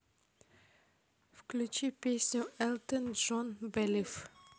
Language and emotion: Russian, neutral